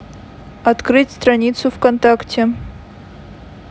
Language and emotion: Russian, neutral